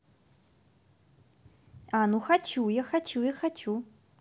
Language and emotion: Russian, positive